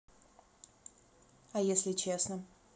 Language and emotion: Russian, neutral